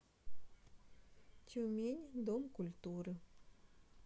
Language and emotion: Russian, neutral